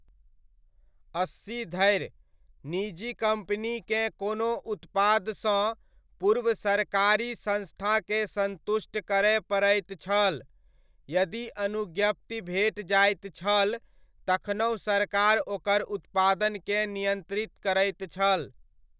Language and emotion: Maithili, neutral